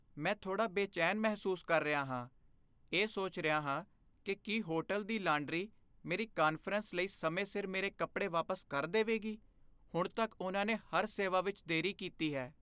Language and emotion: Punjabi, fearful